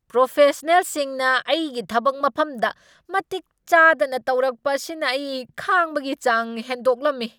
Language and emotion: Manipuri, angry